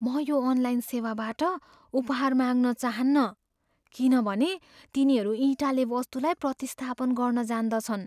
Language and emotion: Nepali, fearful